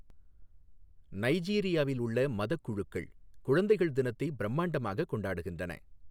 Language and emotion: Tamil, neutral